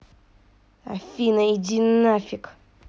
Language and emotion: Russian, angry